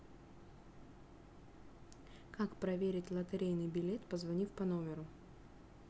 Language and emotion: Russian, neutral